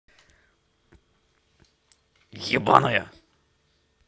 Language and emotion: Russian, angry